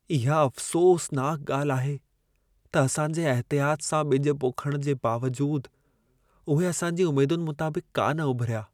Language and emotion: Sindhi, sad